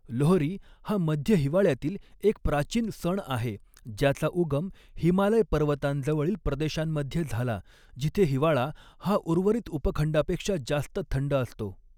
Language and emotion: Marathi, neutral